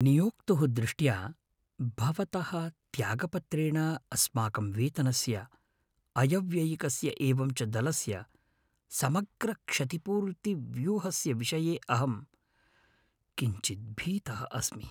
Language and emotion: Sanskrit, fearful